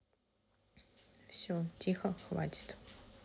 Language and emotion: Russian, neutral